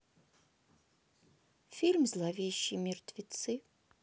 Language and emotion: Russian, sad